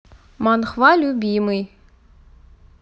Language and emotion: Russian, neutral